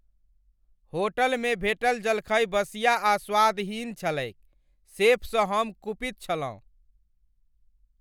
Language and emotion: Maithili, angry